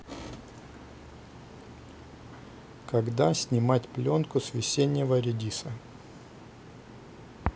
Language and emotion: Russian, neutral